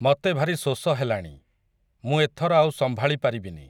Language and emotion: Odia, neutral